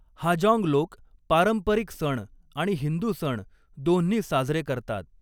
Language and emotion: Marathi, neutral